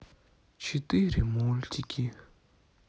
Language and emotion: Russian, sad